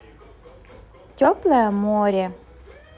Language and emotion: Russian, positive